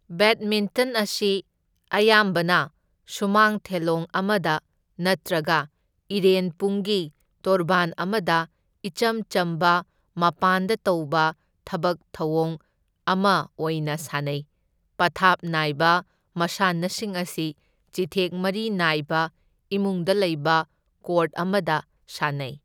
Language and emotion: Manipuri, neutral